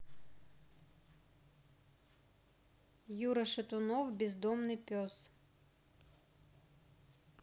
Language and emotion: Russian, neutral